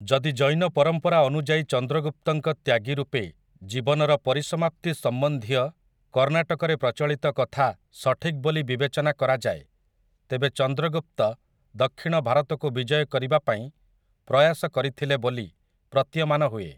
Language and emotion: Odia, neutral